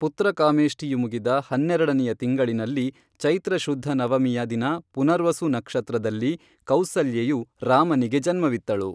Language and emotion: Kannada, neutral